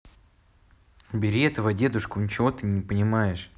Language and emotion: Russian, neutral